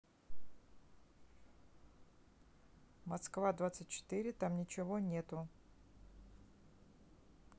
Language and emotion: Russian, neutral